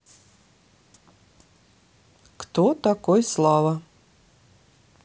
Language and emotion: Russian, neutral